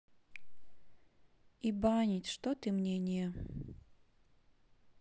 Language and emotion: Russian, sad